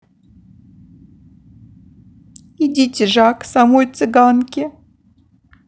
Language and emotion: Russian, sad